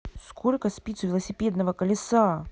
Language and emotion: Russian, angry